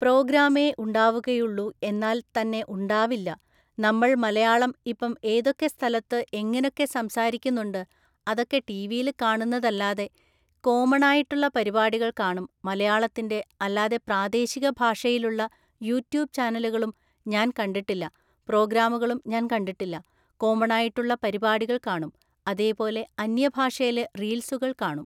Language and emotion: Malayalam, neutral